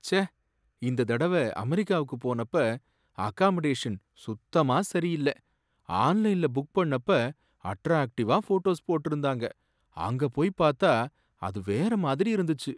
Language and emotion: Tamil, sad